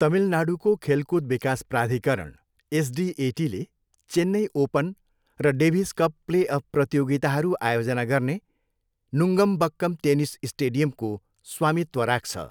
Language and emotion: Nepali, neutral